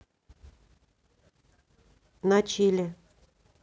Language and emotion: Russian, neutral